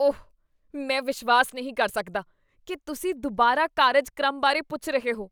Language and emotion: Punjabi, disgusted